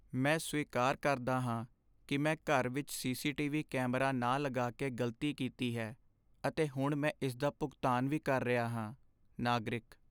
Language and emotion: Punjabi, sad